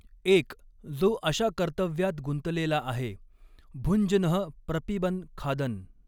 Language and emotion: Marathi, neutral